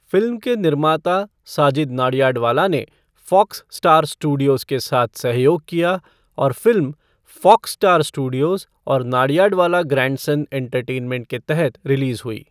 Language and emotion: Hindi, neutral